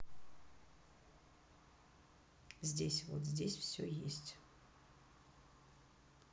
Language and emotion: Russian, neutral